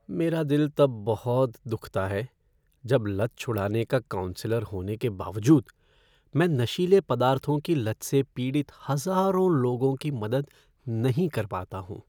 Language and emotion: Hindi, sad